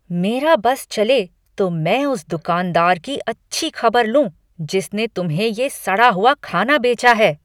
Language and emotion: Hindi, angry